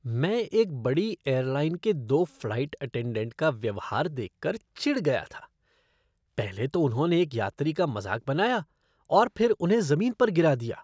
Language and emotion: Hindi, disgusted